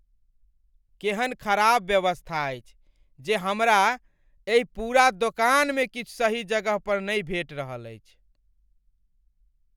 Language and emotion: Maithili, angry